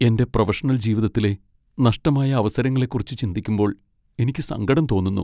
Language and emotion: Malayalam, sad